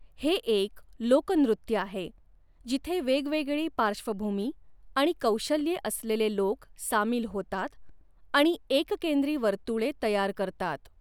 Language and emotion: Marathi, neutral